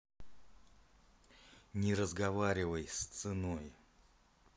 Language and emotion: Russian, angry